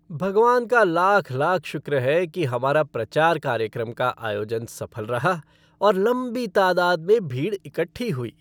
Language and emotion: Hindi, happy